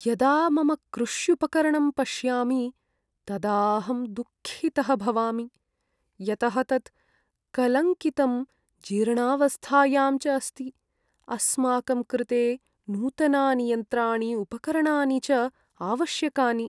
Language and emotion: Sanskrit, sad